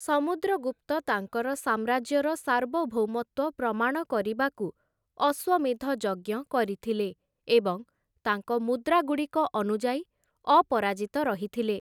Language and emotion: Odia, neutral